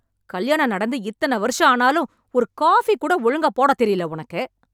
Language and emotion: Tamil, angry